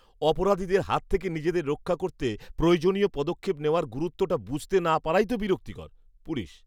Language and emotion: Bengali, disgusted